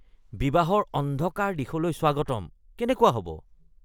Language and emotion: Assamese, disgusted